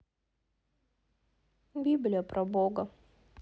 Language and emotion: Russian, sad